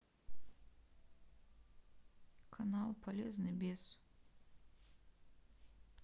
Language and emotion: Russian, sad